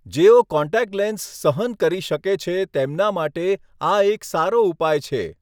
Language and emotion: Gujarati, neutral